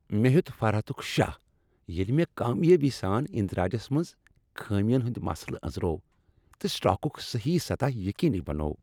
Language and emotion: Kashmiri, happy